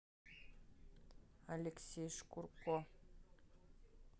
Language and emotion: Russian, neutral